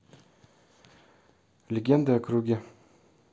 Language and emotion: Russian, neutral